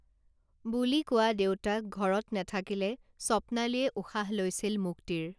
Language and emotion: Assamese, neutral